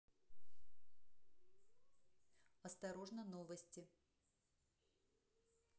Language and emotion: Russian, neutral